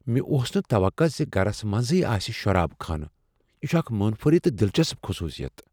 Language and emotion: Kashmiri, surprised